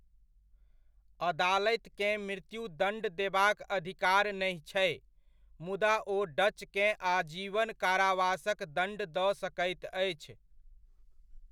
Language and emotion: Maithili, neutral